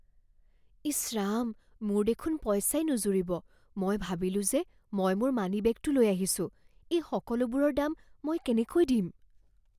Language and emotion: Assamese, fearful